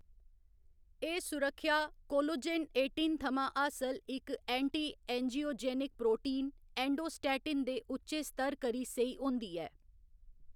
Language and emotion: Dogri, neutral